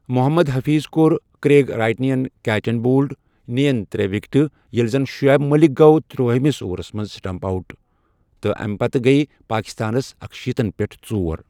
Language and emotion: Kashmiri, neutral